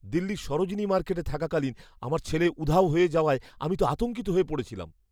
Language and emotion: Bengali, fearful